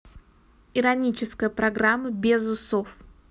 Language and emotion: Russian, neutral